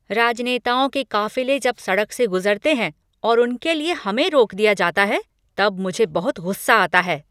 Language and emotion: Hindi, angry